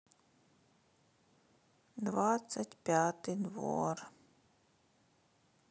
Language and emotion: Russian, sad